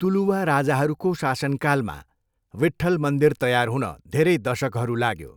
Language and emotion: Nepali, neutral